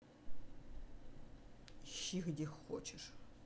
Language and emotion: Russian, angry